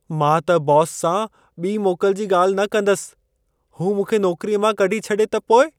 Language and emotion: Sindhi, fearful